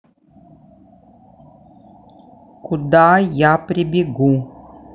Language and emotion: Russian, angry